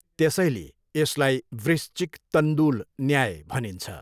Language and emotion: Nepali, neutral